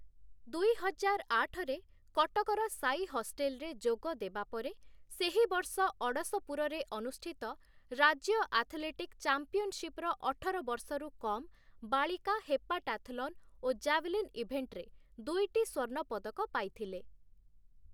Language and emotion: Odia, neutral